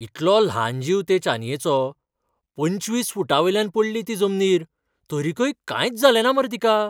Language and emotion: Goan Konkani, surprised